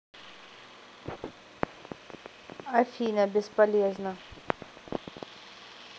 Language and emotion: Russian, neutral